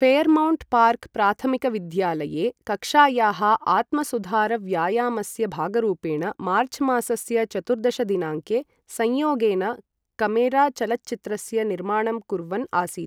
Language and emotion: Sanskrit, neutral